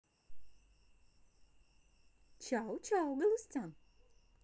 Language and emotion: Russian, positive